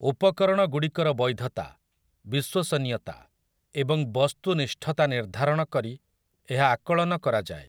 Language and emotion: Odia, neutral